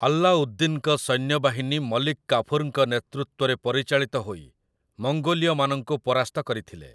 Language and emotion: Odia, neutral